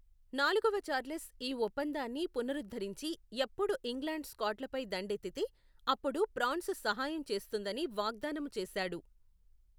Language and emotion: Telugu, neutral